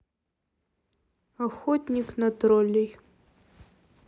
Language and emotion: Russian, neutral